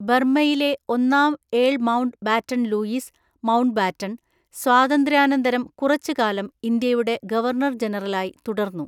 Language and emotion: Malayalam, neutral